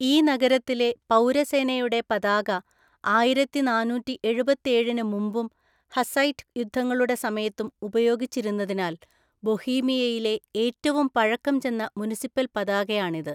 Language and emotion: Malayalam, neutral